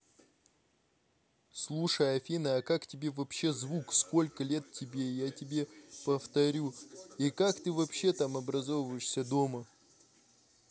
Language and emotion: Russian, neutral